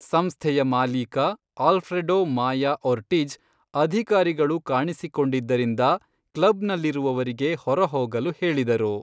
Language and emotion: Kannada, neutral